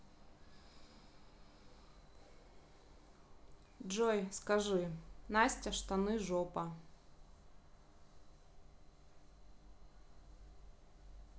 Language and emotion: Russian, neutral